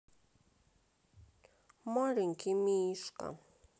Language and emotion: Russian, sad